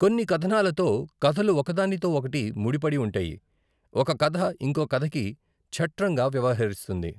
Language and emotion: Telugu, neutral